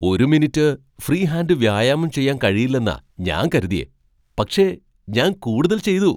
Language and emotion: Malayalam, surprised